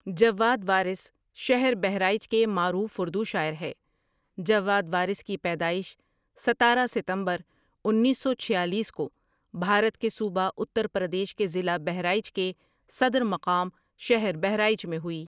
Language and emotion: Urdu, neutral